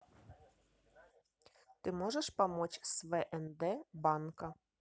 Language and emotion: Russian, neutral